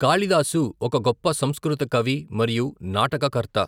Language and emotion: Telugu, neutral